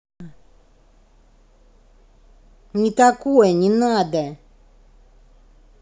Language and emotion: Russian, angry